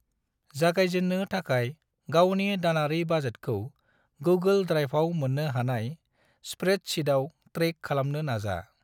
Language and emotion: Bodo, neutral